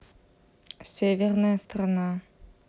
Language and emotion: Russian, neutral